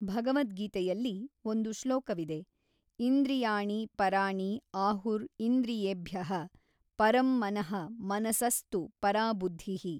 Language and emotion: Kannada, neutral